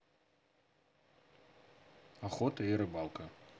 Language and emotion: Russian, neutral